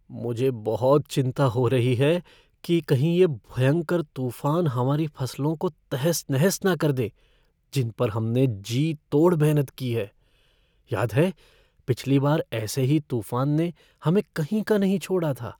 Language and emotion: Hindi, fearful